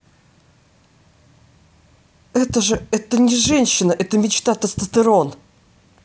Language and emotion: Russian, positive